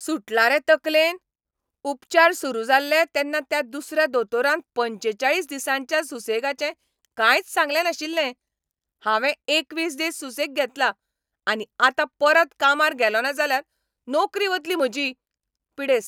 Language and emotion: Goan Konkani, angry